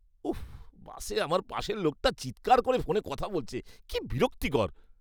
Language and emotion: Bengali, disgusted